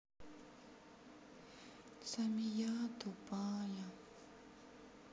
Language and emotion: Russian, sad